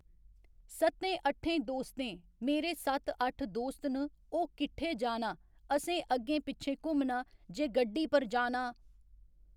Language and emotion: Dogri, neutral